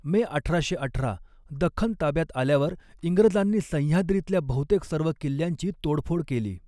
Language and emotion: Marathi, neutral